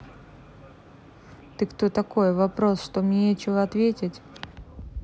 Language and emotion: Russian, neutral